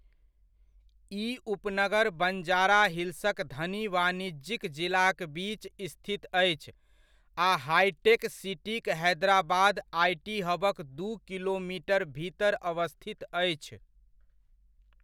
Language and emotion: Maithili, neutral